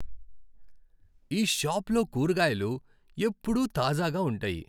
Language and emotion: Telugu, happy